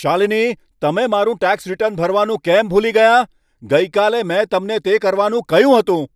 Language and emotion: Gujarati, angry